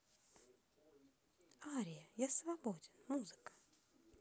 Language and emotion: Russian, neutral